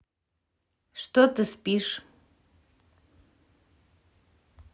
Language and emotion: Russian, neutral